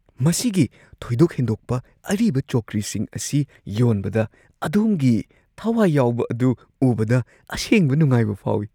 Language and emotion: Manipuri, surprised